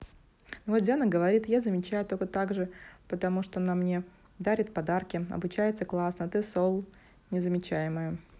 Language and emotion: Russian, neutral